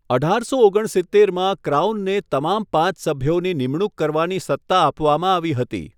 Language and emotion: Gujarati, neutral